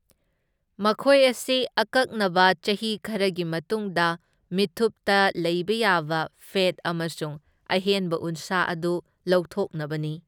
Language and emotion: Manipuri, neutral